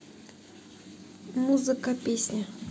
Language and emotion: Russian, neutral